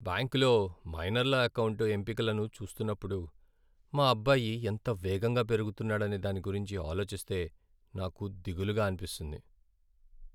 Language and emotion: Telugu, sad